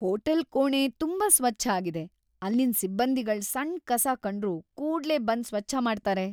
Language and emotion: Kannada, happy